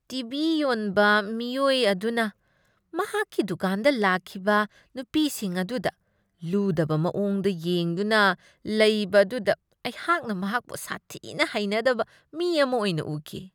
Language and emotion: Manipuri, disgusted